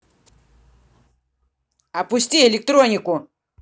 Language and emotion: Russian, angry